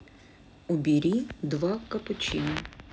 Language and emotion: Russian, neutral